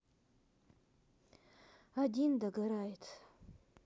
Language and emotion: Russian, sad